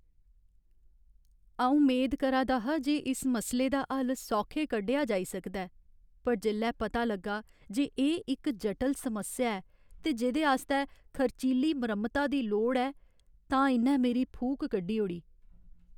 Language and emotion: Dogri, sad